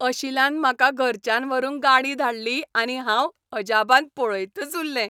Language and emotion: Goan Konkani, happy